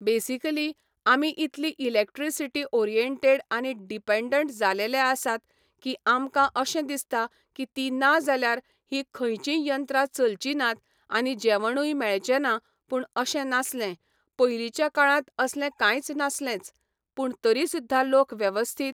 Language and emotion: Goan Konkani, neutral